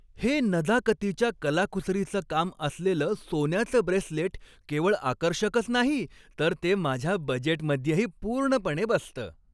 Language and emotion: Marathi, happy